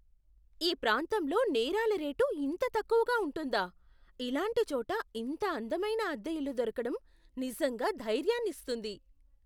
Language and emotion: Telugu, surprised